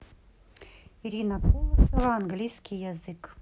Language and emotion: Russian, neutral